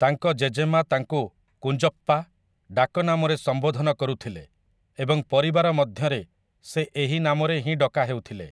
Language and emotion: Odia, neutral